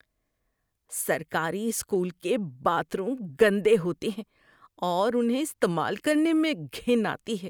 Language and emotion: Urdu, disgusted